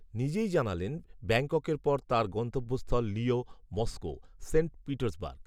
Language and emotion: Bengali, neutral